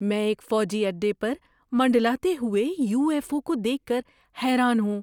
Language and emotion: Urdu, surprised